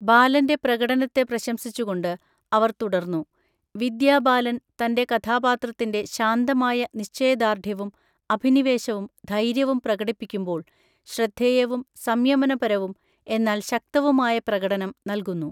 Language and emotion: Malayalam, neutral